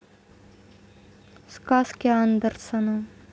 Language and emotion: Russian, neutral